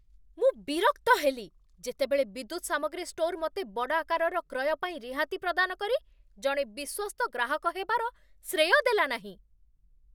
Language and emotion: Odia, angry